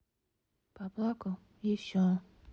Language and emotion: Russian, sad